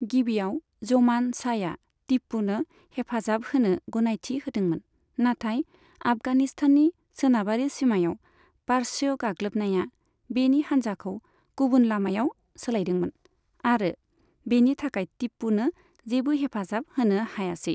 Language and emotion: Bodo, neutral